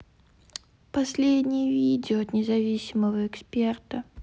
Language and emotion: Russian, sad